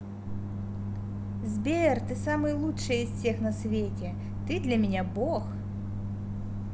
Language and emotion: Russian, positive